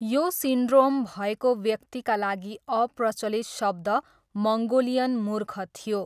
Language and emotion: Nepali, neutral